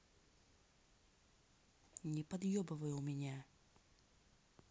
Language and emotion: Russian, angry